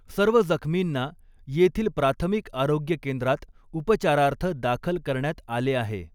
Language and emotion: Marathi, neutral